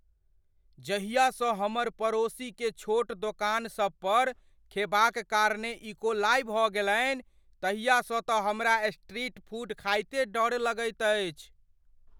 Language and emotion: Maithili, fearful